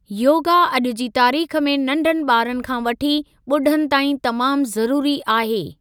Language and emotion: Sindhi, neutral